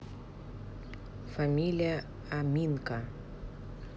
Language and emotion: Russian, neutral